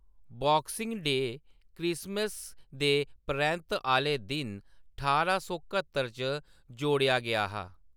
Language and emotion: Dogri, neutral